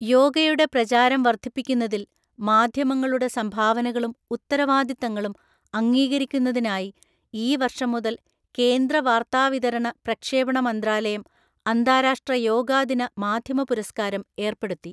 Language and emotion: Malayalam, neutral